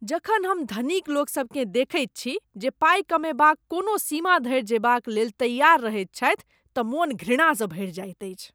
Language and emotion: Maithili, disgusted